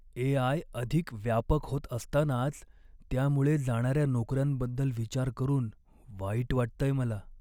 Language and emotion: Marathi, sad